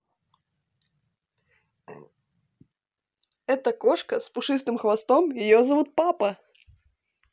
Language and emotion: Russian, positive